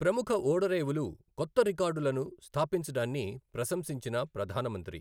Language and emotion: Telugu, neutral